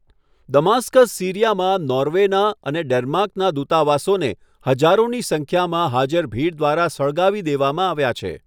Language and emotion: Gujarati, neutral